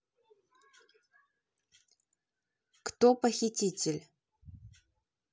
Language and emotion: Russian, neutral